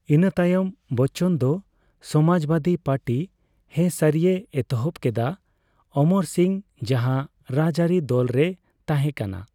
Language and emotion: Santali, neutral